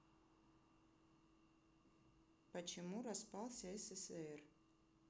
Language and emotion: Russian, neutral